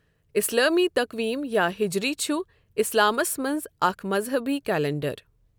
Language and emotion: Kashmiri, neutral